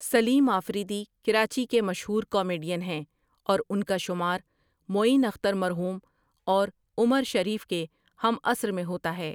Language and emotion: Urdu, neutral